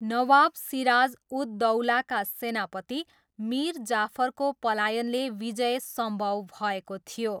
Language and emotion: Nepali, neutral